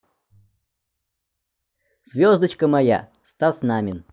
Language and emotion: Russian, positive